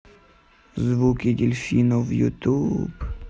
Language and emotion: Russian, sad